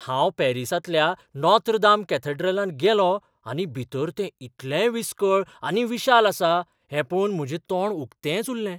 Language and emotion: Goan Konkani, surprised